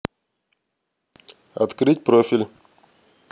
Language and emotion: Russian, neutral